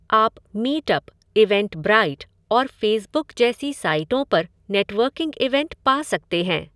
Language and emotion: Hindi, neutral